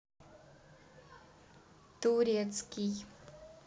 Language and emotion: Russian, neutral